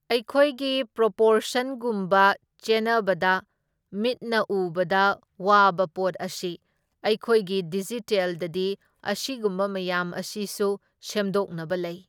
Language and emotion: Manipuri, neutral